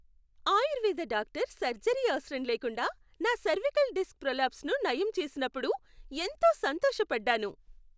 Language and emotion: Telugu, happy